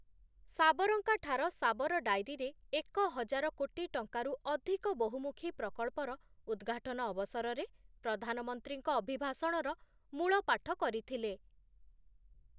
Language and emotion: Odia, neutral